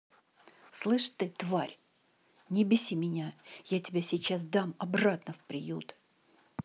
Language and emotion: Russian, angry